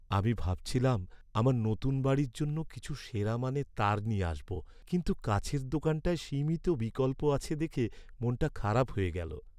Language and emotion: Bengali, sad